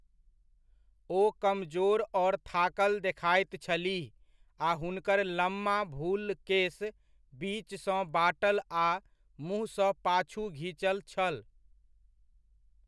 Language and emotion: Maithili, neutral